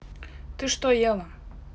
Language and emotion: Russian, neutral